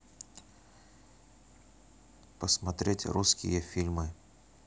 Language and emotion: Russian, neutral